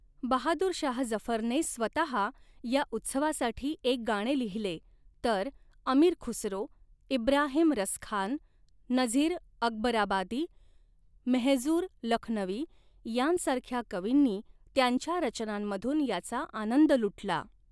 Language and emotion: Marathi, neutral